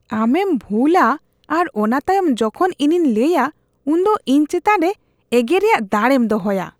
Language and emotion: Santali, disgusted